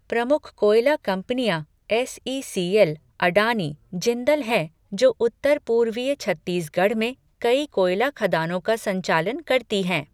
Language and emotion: Hindi, neutral